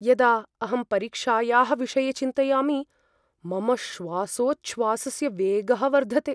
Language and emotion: Sanskrit, fearful